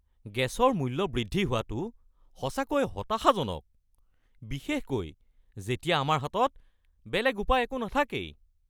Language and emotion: Assamese, angry